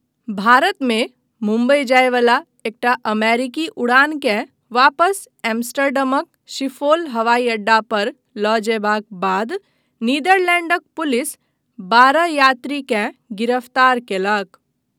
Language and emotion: Maithili, neutral